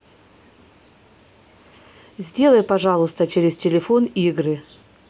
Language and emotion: Russian, neutral